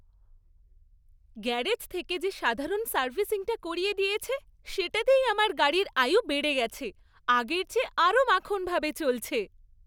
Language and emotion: Bengali, happy